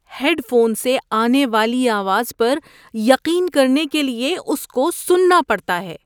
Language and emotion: Urdu, surprised